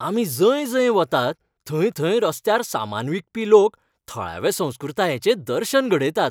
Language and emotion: Goan Konkani, happy